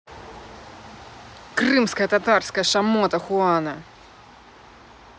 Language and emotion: Russian, angry